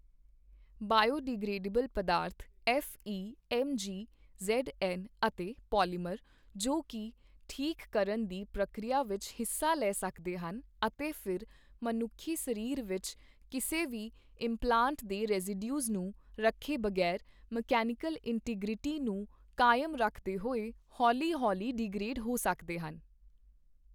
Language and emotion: Punjabi, neutral